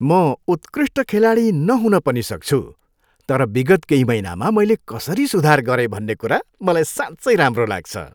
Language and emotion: Nepali, happy